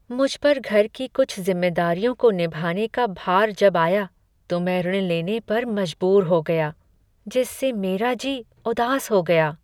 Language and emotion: Hindi, sad